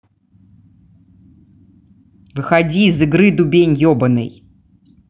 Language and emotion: Russian, angry